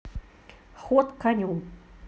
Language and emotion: Russian, neutral